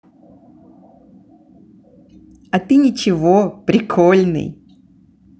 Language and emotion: Russian, positive